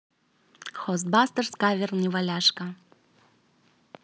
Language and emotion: Russian, neutral